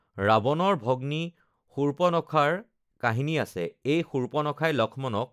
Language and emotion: Assamese, neutral